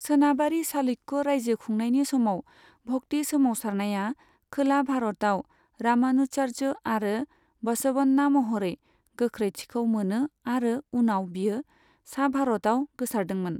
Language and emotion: Bodo, neutral